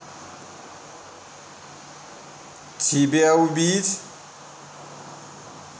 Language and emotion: Russian, angry